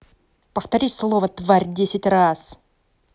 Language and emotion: Russian, angry